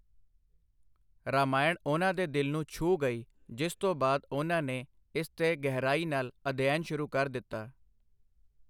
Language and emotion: Punjabi, neutral